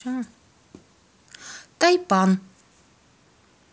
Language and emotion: Russian, neutral